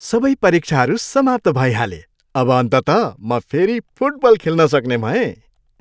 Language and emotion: Nepali, happy